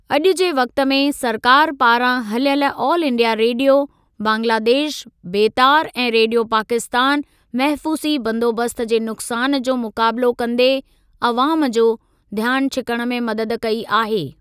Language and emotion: Sindhi, neutral